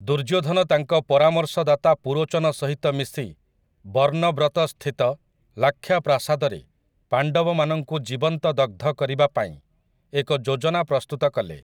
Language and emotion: Odia, neutral